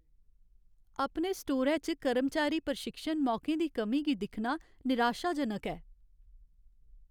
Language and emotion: Dogri, sad